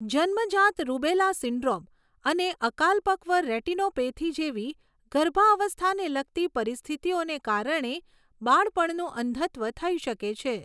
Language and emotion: Gujarati, neutral